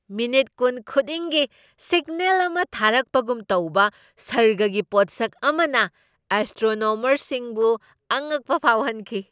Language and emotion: Manipuri, surprised